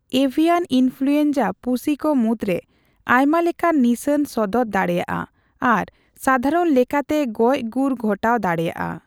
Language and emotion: Santali, neutral